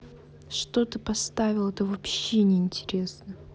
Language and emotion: Russian, angry